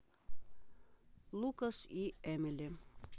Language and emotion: Russian, neutral